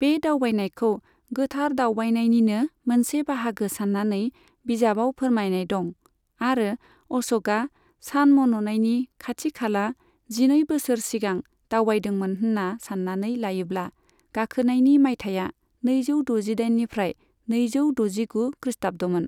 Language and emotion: Bodo, neutral